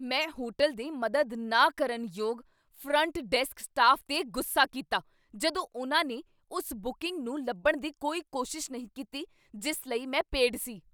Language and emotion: Punjabi, angry